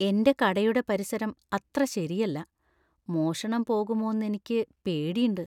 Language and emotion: Malayalam, fearful